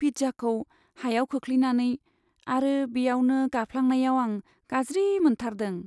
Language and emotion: Bodo, sad